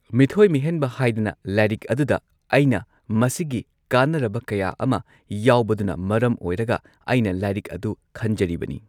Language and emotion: Manipuri, neutral